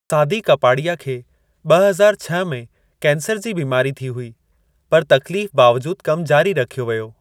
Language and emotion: Sindhi, neutral